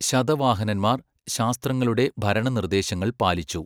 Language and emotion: Malayalam, neutral